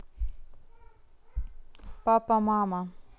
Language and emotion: Russian, neutral